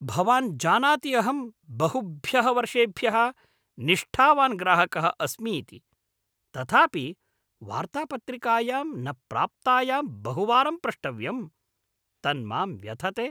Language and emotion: Sanskrit, angry